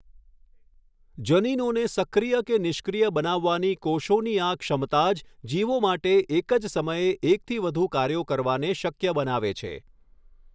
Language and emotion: Gujarati, neutral